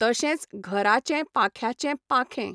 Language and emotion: Goan Konkani, neutral